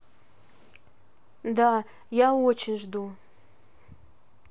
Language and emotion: Russian, neutral